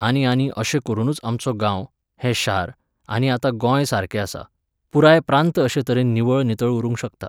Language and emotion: Goan Konkani, neutral